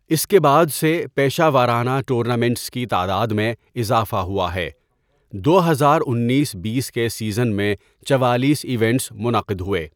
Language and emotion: Urdu, neutral